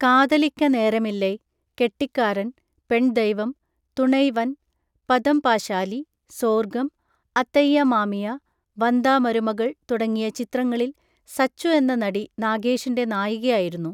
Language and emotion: Malayalam, neutral